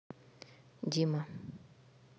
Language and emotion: Russian, neutral